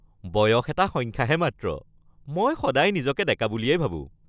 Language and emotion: Assamese, happy